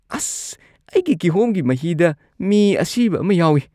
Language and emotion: Manipuri, disgusted